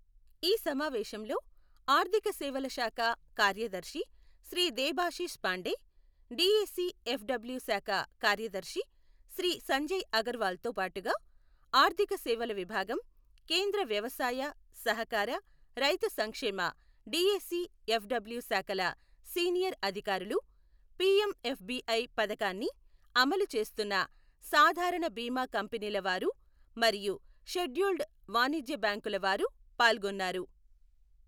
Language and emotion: Telugu, neutral